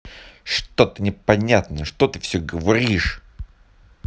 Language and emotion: Russian, angry